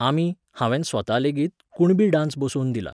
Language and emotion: Goan Konkani, neutral